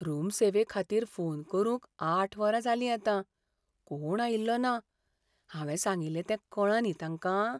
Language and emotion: Goan Konkani, fearful